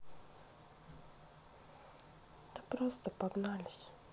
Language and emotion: Russian, sad